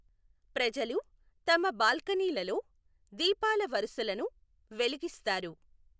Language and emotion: Telugu, neutral